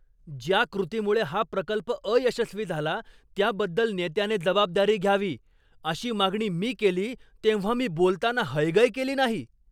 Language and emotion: Marathi, angry